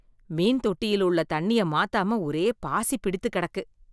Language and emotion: Tamil, disgusted